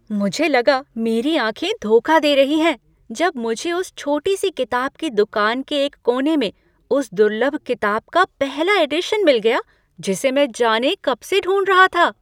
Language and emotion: Hindi, surprised